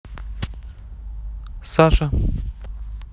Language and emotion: Russian, neutral